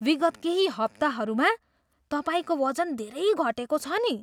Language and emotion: Nepali, surprised